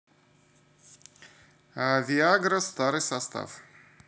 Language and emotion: Russian, neutral